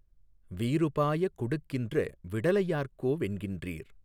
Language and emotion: Tamil, neutral